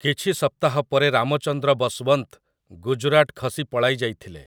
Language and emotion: Odia, neutral